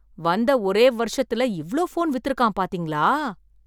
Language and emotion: Tamil, surprised